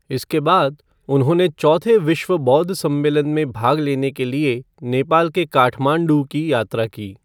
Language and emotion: Hindi, neutral